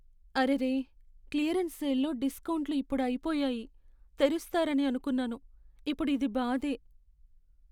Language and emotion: Telugu, sad